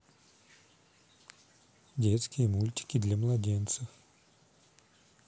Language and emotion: Russian, neutral